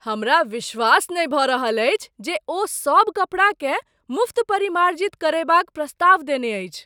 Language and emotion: Maithili, surprised